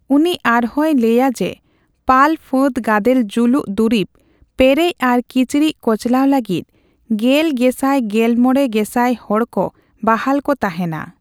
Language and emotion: Santali, neutral